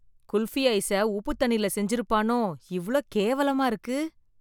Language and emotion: Tamil, disgusted